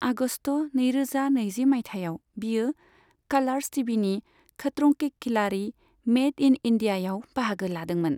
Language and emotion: Bodo, neutral